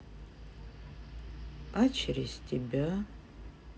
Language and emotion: Russian, sad